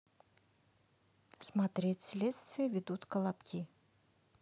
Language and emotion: Russian, neutral